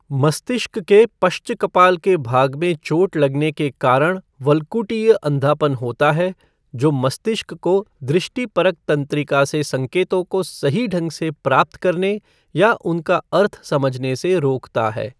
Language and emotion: Hindi, neutral